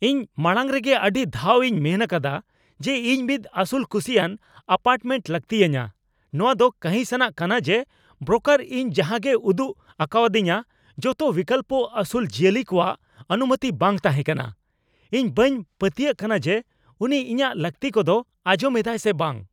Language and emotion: Santali, angry